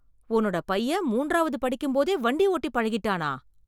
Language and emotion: Tamil, surprised